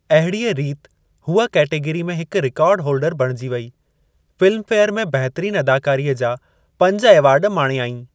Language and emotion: Sindhi, neutral